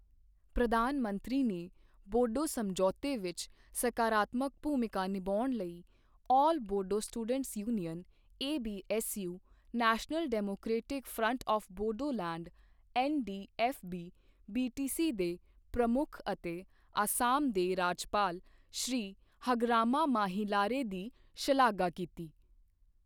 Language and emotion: Punjabi, neutral